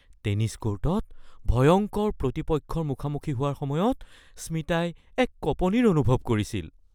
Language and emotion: Assamese, fearful